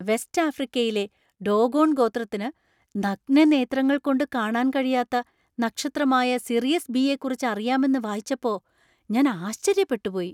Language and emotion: Malayalam, surprised